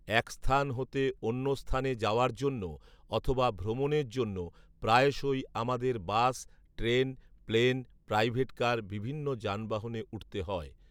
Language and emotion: Bengali, neutral